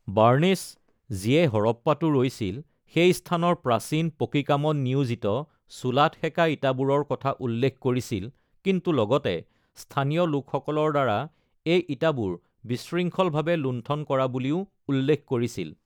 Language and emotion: Assamese, neutral